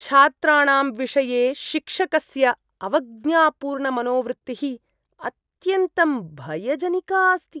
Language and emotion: Sanskrit, disgusted